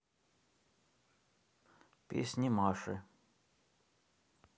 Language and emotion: Russian, neutral